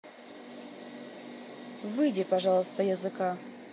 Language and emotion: Russian, neutral